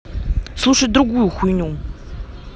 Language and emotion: Russian, angry